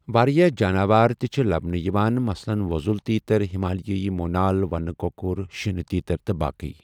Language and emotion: Kashmiri, neutral